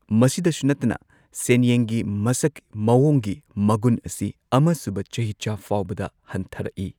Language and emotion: Manipuri, neutral